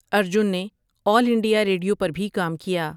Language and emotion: Urdu, neutral